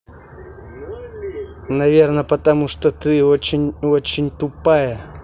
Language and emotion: Russian, angry